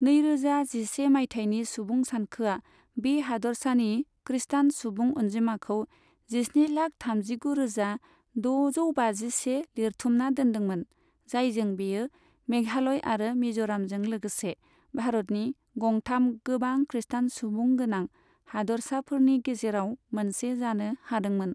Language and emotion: Bodo, neutral